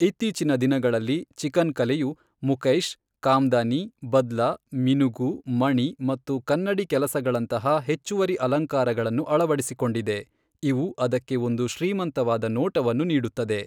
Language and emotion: Kannada, neutral